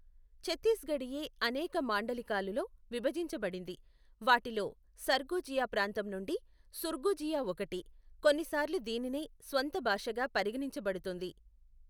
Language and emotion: Telugu, neutral